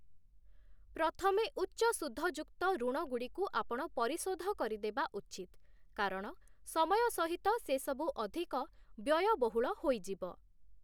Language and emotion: Odia, neutral